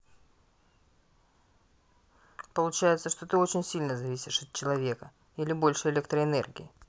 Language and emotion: Russian, neutral